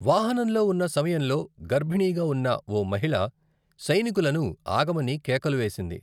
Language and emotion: Telugu, neutral